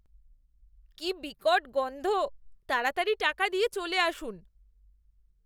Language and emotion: Bengali, disgusted